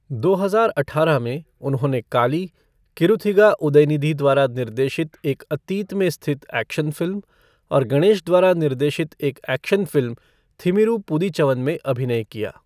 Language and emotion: Hindi, neutral